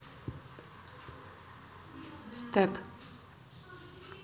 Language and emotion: Russian, neutral